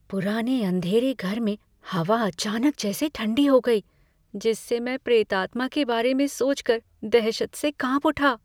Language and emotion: Hindi, fearful